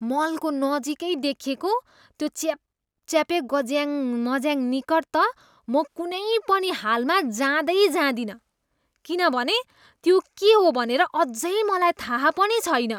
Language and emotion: Nepali, disgusted